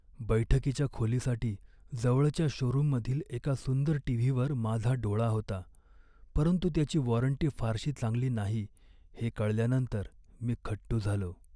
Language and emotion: Marathi, sad